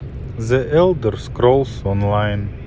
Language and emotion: Russian, neutral